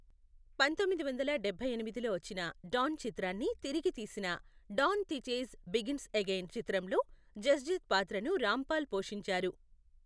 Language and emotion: Telugu, neutral